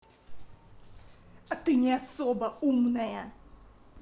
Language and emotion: Russian, angry